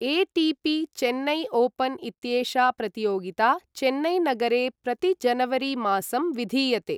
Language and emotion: Sanskrit, neutral